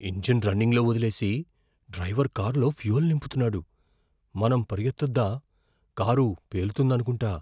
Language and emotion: Telugu, fearful